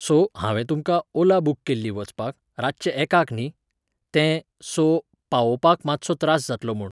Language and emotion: Goan Konkani, neutral